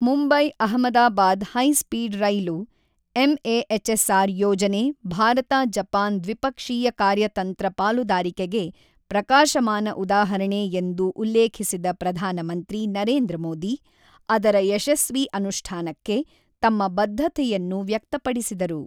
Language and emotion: Kannada, neutral